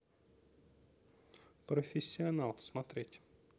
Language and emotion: Russian, neutral